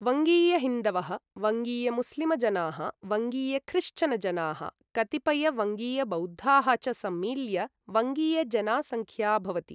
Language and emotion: Sanskrit, neutral